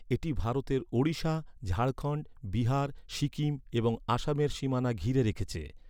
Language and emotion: Bengali, neutral